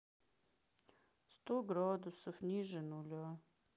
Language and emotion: Russian, sad